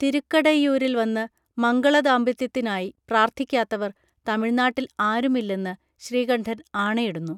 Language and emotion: Malayalam, neutral